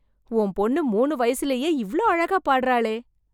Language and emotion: Tamil, surprised